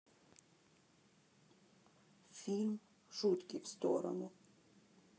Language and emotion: Russian, sad